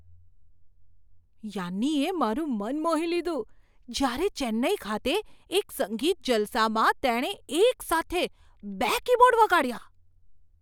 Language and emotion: Gujarati, surprised